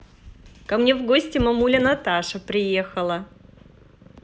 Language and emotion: Russian, positive